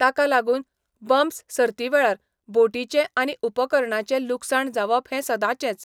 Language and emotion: Goan Konkani, neutral